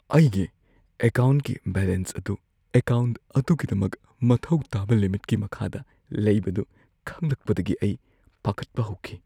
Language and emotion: Manipuri, fearful